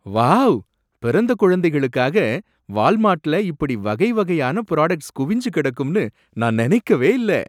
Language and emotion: Tamil, surprised